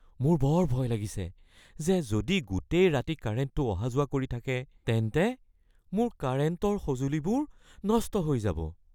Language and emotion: Assamese, fearful